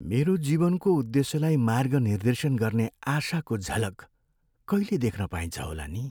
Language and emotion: Nepali, sad